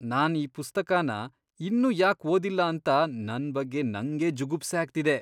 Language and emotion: Kannada, disgusted